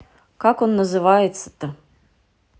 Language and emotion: Russian, angry